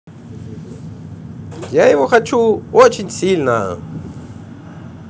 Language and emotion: Russian, positive